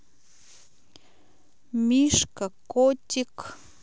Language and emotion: Russian, neutral